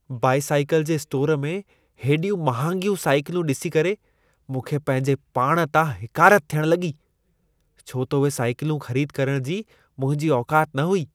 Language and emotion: Sindhi, disgusted